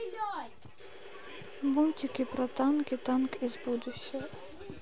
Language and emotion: Russian, sad